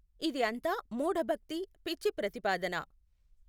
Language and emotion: Telugu, neutral